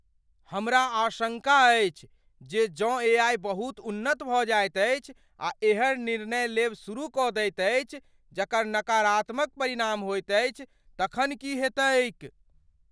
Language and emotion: Maithili, fearful